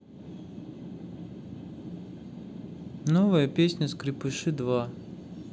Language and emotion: Russian, neutral